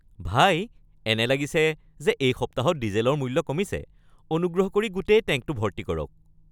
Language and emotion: Assamese, happy